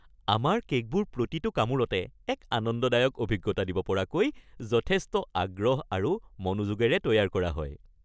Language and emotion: Assamese, happy